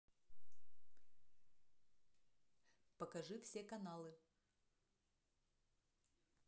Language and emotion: Russian, neutral